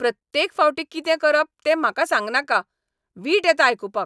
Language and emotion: Goan Konkani, angry